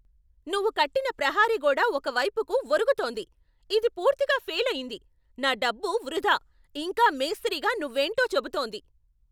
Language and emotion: Telugu, angry